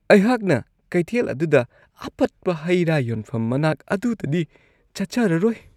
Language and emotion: Manipuri, disgusted